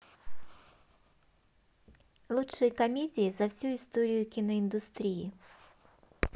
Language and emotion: Russian, positive